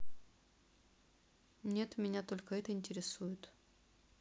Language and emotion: Russian, neutral